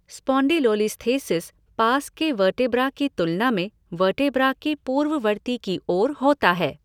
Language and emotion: Hindi, neutral